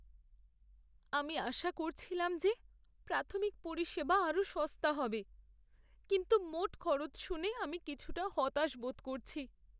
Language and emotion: Bengali, sad